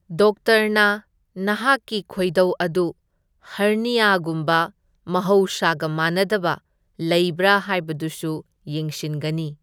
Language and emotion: Manipuri, neutral